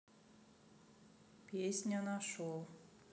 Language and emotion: Russian, neutral